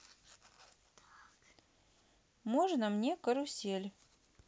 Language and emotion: Russian, neutral